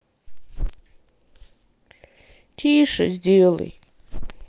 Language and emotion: Russian, sad